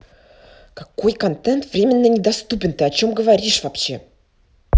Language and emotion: Russian, angry